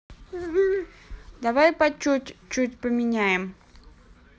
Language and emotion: Russian, neutral